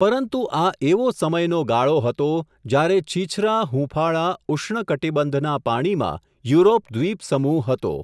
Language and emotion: Gujarati, neutral